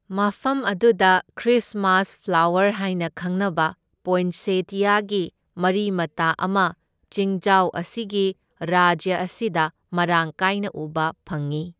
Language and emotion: Manipuri, neutral